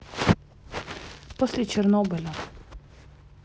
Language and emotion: Russian, neutral